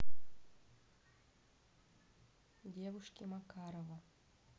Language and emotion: Russian, neutral